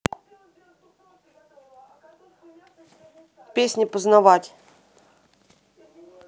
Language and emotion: Russian, neutral